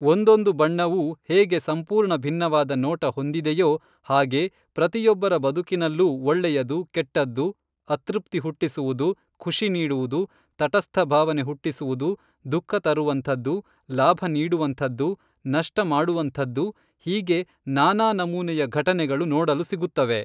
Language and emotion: Kannada, neutral